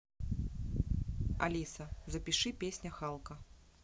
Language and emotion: Russian, neutral